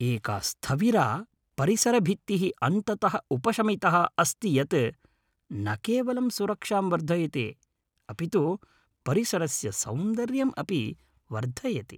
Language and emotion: Sanskrit, happy